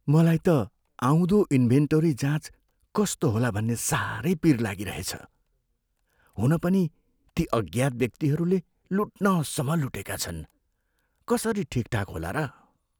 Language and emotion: Nepali, fearful